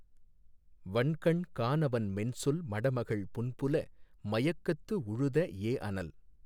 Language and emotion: Tamil, neutral